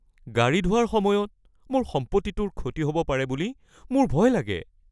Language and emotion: Assamese, fearful